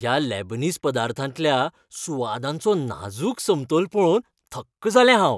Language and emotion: Goan Konkani, happy